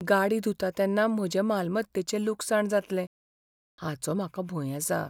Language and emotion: Goan Konkani, fearful